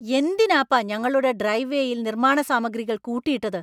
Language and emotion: Malayalam, angry